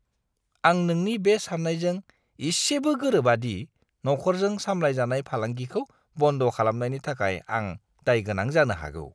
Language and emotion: Bodo, disgusted